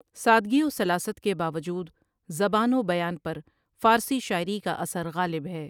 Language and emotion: Urdu, neutral